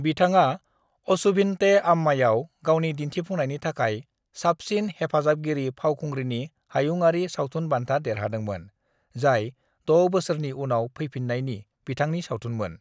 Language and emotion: Bodo, neutral